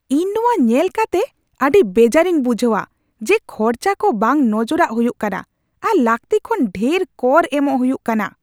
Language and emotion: Santali, angry